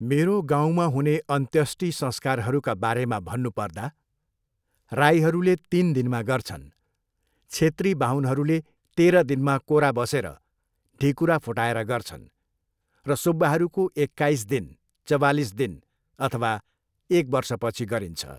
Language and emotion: Nepali, neutral